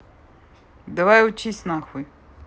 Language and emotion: Russian, angry